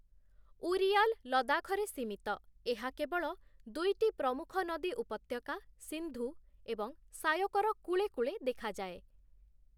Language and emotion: Odia, neutral